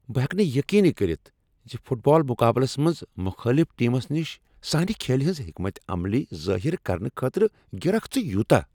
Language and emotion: Kashmiri, angry